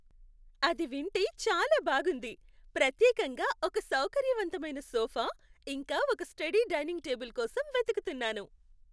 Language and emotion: Telugu, happy